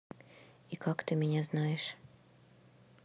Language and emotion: Russian, neutral